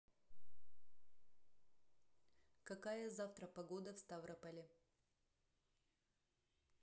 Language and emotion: Russian, neutral